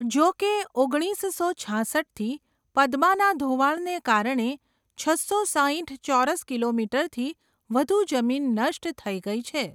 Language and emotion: Gujarati, neutral